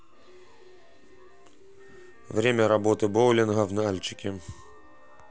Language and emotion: Russian, neutral